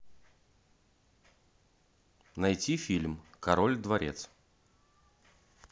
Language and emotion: Russian, neutral